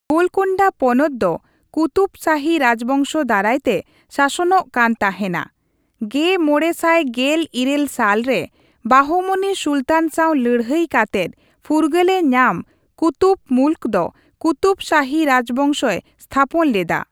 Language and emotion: Santali, neutral